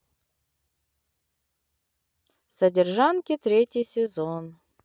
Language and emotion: Russian, neutral